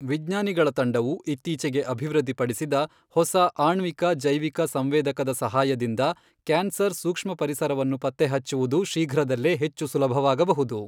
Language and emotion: Kannada, neutral